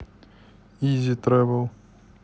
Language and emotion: Russian, neutral